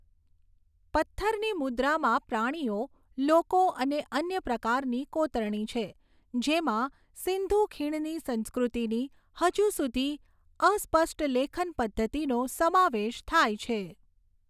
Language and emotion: Gujarati, neutral